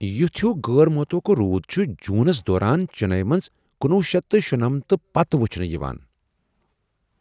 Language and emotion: Kashmiri, surprised